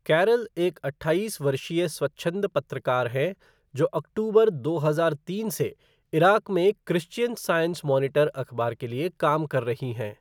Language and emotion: Hindi, neutral